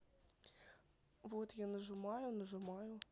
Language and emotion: Russian, neutral